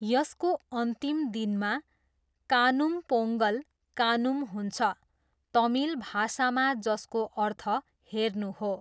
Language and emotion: Nepali, neutral